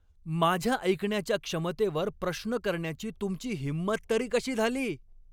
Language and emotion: Marathi, angry